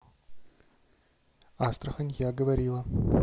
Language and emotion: Russian, neutral